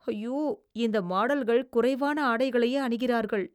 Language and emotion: Tamil, disgusted